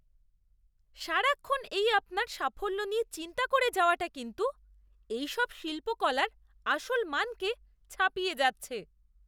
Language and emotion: Bengali, disgusted